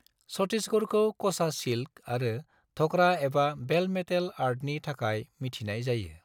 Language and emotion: Bodo, neutral